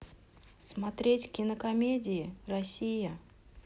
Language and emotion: Russian, neutral